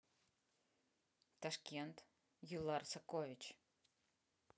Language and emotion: Russian, neutral